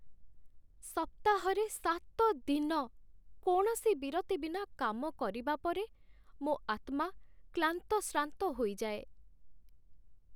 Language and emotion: Odia, sad